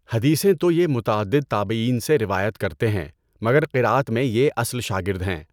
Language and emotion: Urdu, neutral